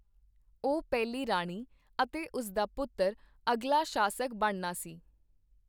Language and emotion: Punjabi, neutral